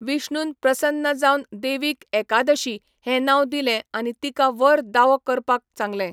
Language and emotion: Goan Konkani, neutral